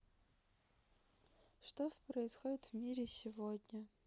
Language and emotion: Russian, sad